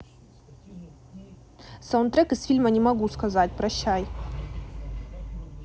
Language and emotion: Russian, neutral